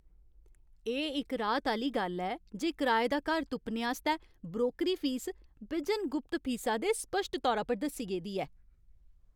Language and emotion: Dogri, happy